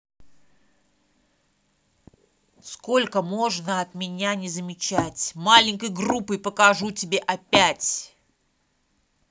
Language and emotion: Russian, angry